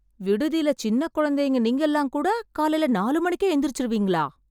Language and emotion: Tamil, surprised